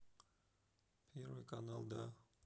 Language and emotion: Russian, neutral